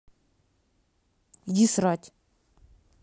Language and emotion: Russian, angry